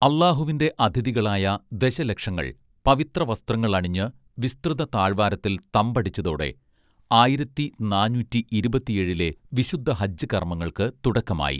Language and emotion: Malayalam, neutral